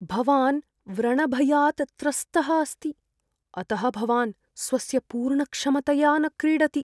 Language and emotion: Sanskrit, fearful